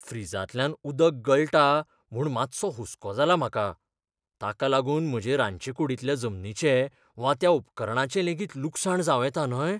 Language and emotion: Goan Konkani, fearful